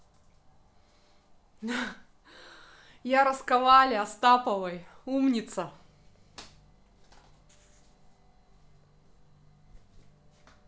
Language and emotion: Russian, positive